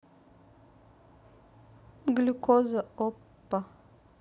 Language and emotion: Russian, neutral